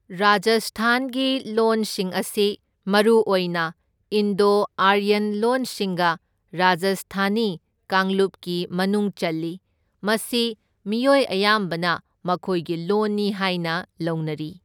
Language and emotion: Manipuri, neutral